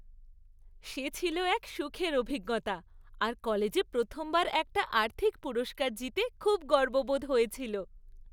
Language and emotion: Bengali, happy